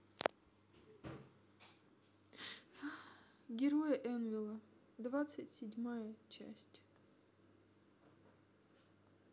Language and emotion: Russian, sad